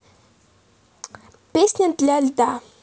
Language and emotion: Russian, neutral